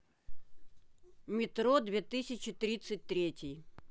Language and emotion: Russian, neutral